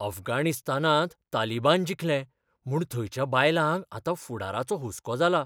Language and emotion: Goan Konkani, fearful